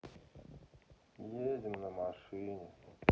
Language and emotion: Russian, sad